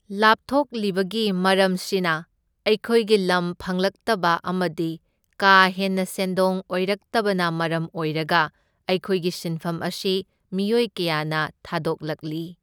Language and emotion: Manipuri, neutral